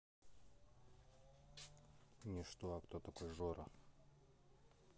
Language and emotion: Russian, neutral